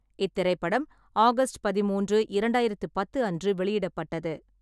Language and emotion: Tamil, neutral